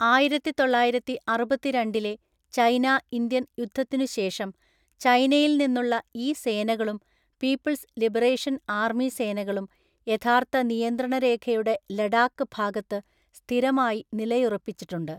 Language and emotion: Malayalam, neutral